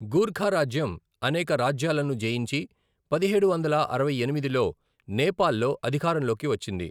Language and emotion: Telugu, neutral